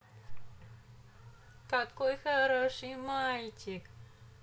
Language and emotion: Russian, positive